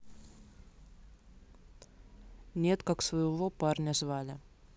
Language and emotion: Russian, neutral